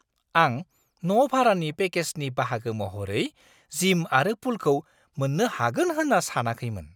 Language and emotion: Bodo, surprised